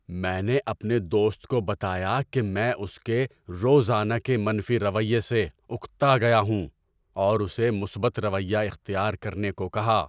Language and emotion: Urdu, angry